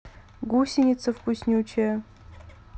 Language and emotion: Russian, neutral